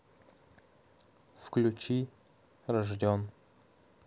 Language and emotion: Russian, neutral